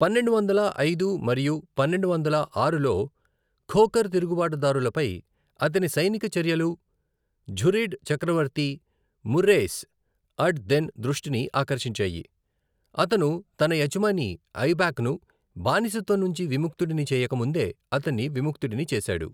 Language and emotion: Telugu, neutral